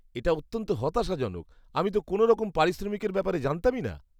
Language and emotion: Bengali, disgusted